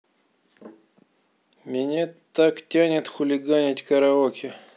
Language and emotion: Russian, neutral